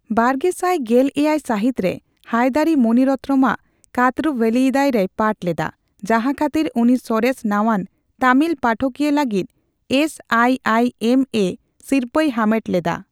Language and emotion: Santali, neutral